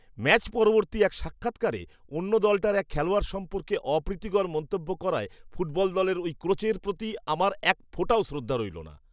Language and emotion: Bengali, disgusted